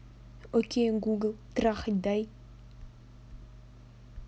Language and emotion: Russian, neutral